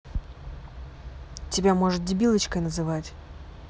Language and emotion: Russian, angry